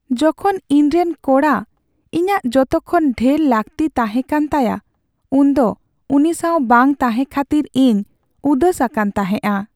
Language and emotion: Santali, sad